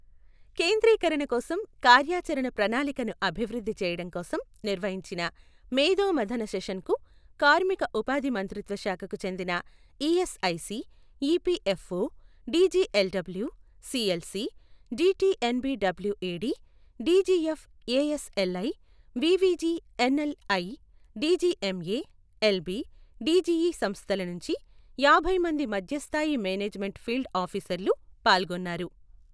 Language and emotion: Telugu, neutral